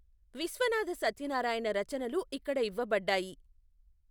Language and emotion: Telugu, neutral